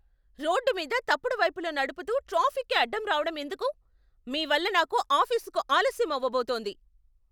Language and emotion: Telugu, angry